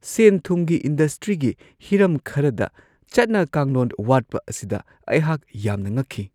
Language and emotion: Manipuri, surprised